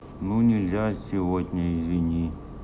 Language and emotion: Russian, sad